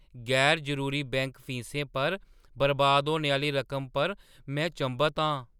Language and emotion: Dogri, surprised